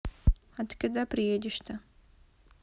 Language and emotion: Russian, neutral